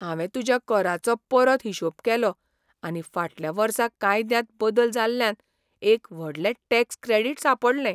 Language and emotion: Goan Konkani, surprised